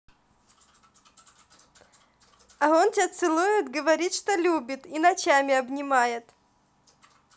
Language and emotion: Russian, positive